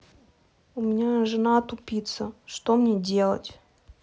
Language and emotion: Russian, neutral